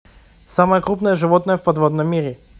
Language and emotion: Russian, neutral